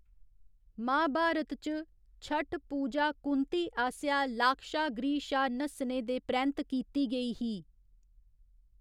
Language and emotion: Dogri, neutral